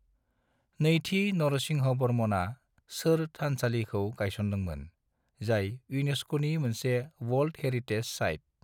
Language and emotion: Bodo, neutral